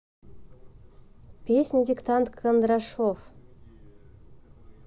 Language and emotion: Russian, neutral